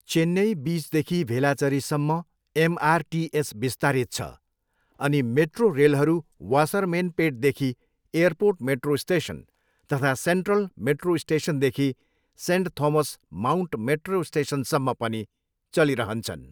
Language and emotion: Nepali, neutral